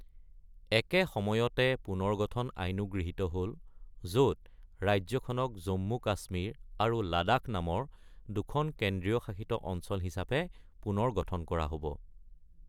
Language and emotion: Assamese, neutral